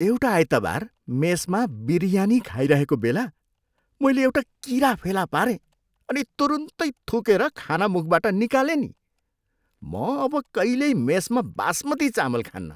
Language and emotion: Nepali, disgusted